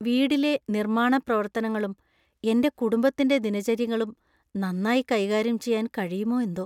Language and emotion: Malayalam, fearful